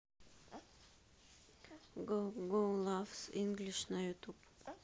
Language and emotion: Russian, sad